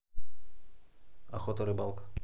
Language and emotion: Russian, neutral